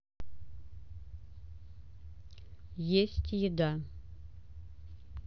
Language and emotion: Russian, neutral